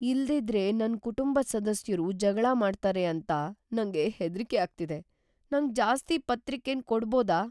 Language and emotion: Kannada, fearful